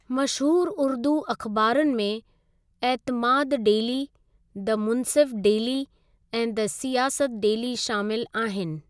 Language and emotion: Sindhi, neutral